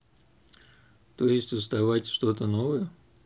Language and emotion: Russian, neutral